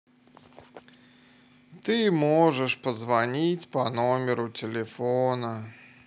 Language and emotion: Russian, sad